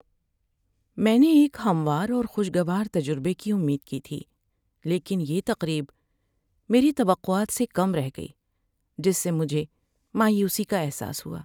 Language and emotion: Urdu, sad